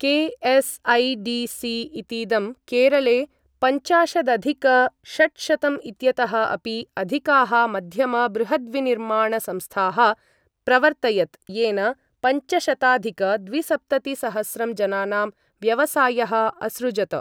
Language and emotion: Sanskrit, neutral